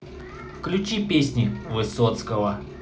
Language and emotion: Russian, positive